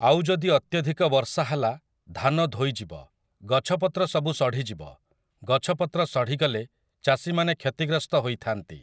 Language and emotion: Odia, neutral